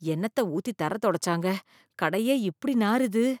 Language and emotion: Tamil, disgusted